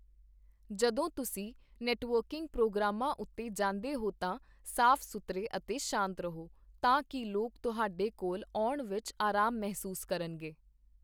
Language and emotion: Punjabi, neutral